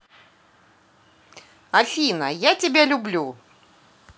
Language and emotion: Russian, positive